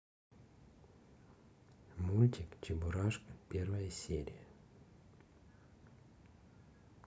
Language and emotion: Russian, neutral